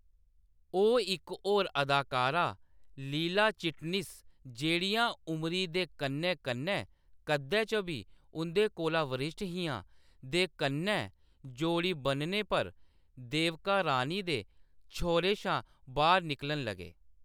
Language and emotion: Dogri, neutral